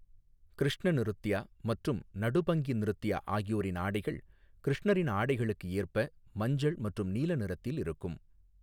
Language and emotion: Tamil, neutral